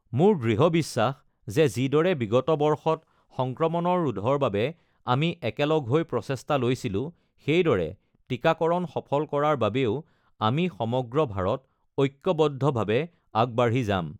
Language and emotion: Assamese, neutral